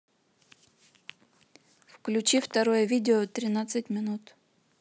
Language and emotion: Russian, neutral